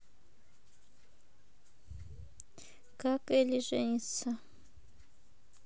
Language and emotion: Russian, neutral